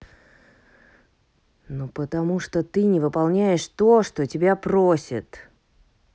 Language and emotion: Russian, angry